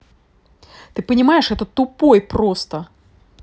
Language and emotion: Russian, angry